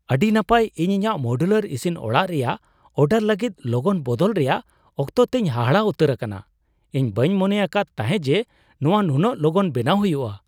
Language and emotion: Santali, surprised